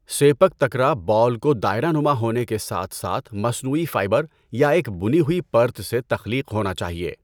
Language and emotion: Urdu, neutral